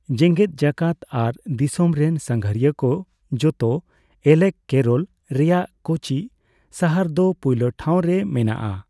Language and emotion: Santali, neutral